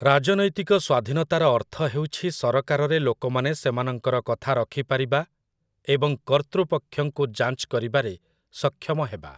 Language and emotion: Odia, neutral